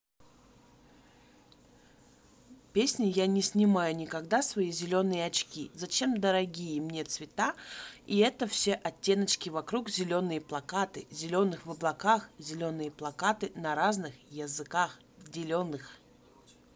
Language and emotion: Russian, neutral